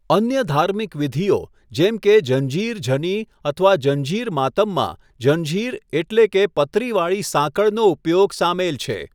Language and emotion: Gujarati, neutral